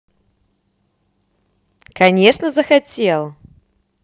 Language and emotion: Russian, positive